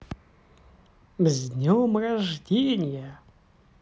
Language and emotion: Russian, positive